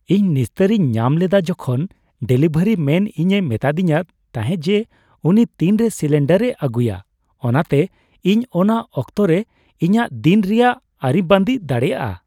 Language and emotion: Santali, happy